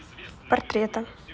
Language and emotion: Russian, neutral